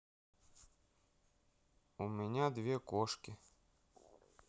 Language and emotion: Russian, neutral